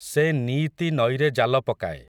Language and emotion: Odia, neutral